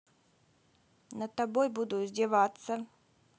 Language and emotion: Russian, neutral